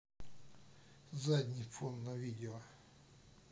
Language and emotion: Russian, neutral